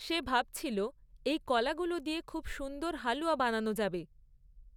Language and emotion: Bengali, neutral